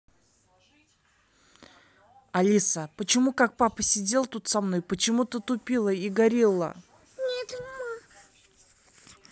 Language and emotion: Russian, angry